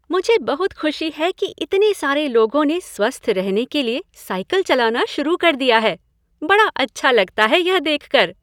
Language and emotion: Hindi, happy